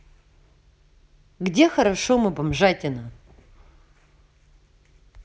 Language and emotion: Russian, neutral